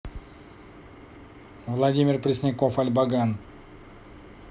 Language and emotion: Russian, neutral